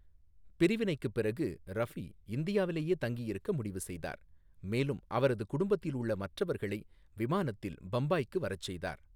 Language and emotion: Tamil, neutral